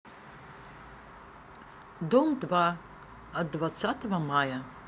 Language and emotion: Russian, neutral